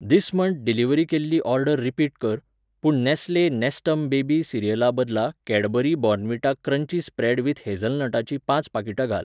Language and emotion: Goan Konkani, neutral